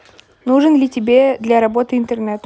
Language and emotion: Russian, neutral